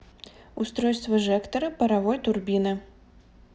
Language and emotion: Russian, neutral